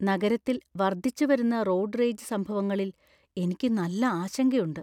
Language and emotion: Malayalam, fearful